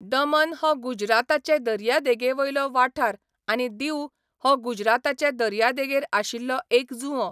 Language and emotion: Goan Konkani, neutral